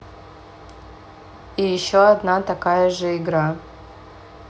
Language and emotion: Russian, neutral